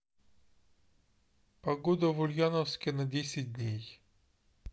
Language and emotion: Russian, neutral